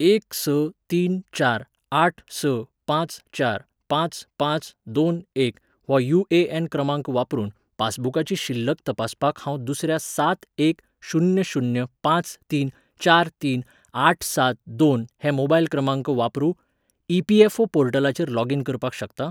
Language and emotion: Goan Konkani, neutral